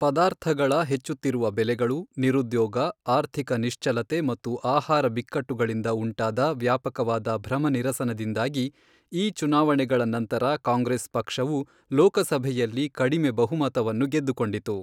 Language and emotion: Kannada, neutral